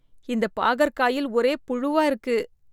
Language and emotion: Tamil, disgusted